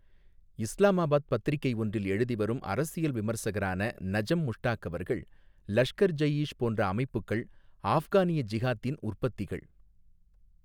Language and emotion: Tamil, neutral